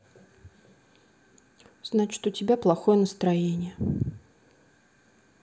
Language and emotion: Russian, sad